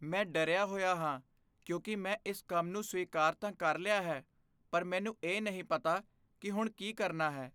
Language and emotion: Punjabi, fearful